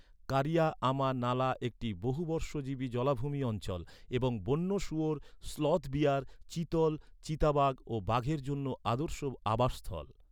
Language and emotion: Bengali, neutral